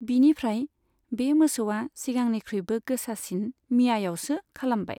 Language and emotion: Bodo, neutral